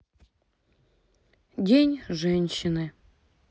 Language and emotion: Russian, sad